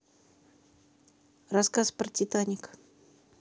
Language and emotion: Russian, neutral